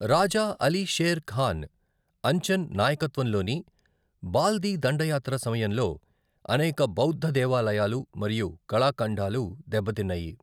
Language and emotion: Telugu, neutral